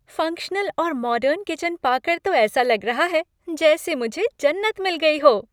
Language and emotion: Hindi, happy